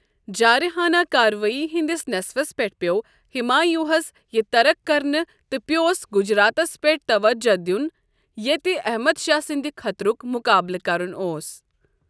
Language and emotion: Kashmiri, neutral